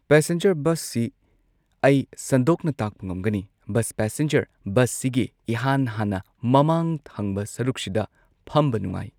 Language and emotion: Manipuri, neutral